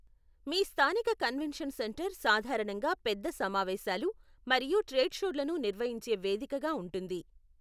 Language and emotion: Telugu, neutral